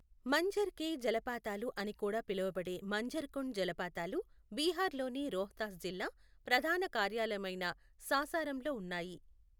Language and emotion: Telugu, neutral